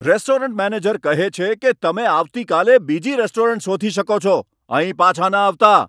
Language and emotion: Gujarati, angry